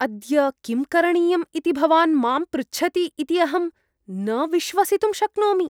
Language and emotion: Sanskrit, disgusted